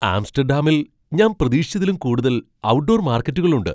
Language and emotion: Malayalam, surprised